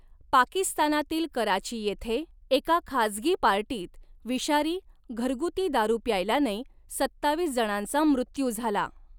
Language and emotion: Marathi, neutral